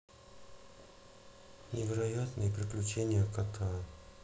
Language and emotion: Russian, neutral